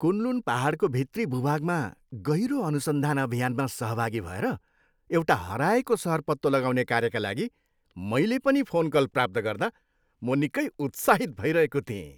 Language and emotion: Nepali, happy